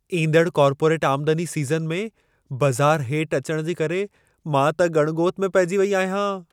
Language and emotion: Sindhi, fearful